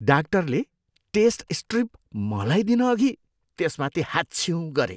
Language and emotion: Nepali, disgusted